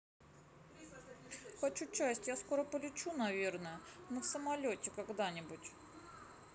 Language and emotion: Russian, sad